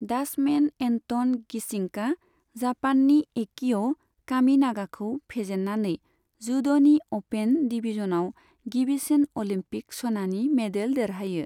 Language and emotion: Bodo, neutral